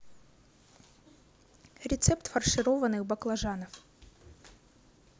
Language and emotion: Russian, neutral